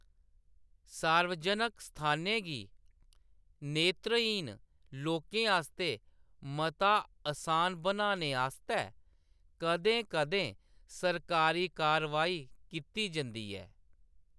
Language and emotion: Dogri, neutral